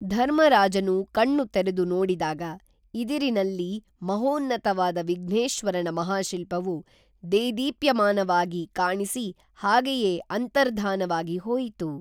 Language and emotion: Kannada, neutral